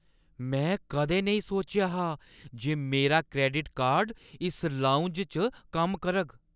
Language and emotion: Dogri, surprised